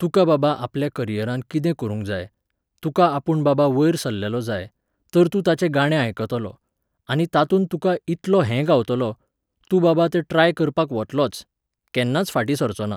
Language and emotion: Goan Konkani, neutral